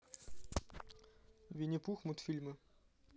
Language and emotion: Russian, neutral